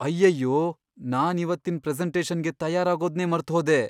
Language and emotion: Kannada, fearful